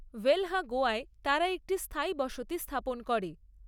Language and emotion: Bengali, neutral